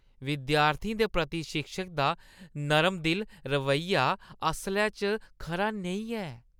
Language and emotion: Dogri, disgusted